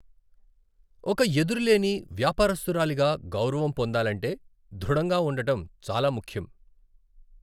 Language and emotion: Telugu, neutral